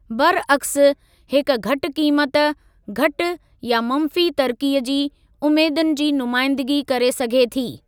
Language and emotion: Sindhi, neutral